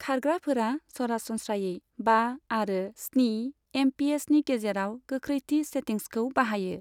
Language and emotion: Bodo, neutral